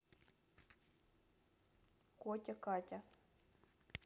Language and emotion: Russian, neutral